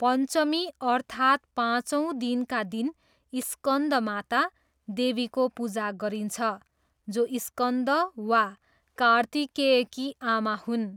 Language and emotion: Nepali, neutral